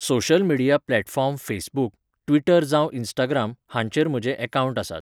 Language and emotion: Goan Konkani, neutral